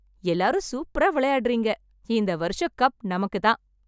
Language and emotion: Tamil, happy